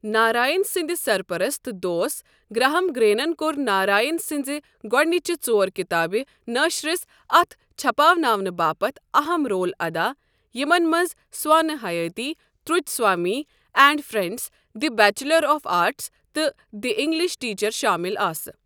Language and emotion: Kashmiri, neutral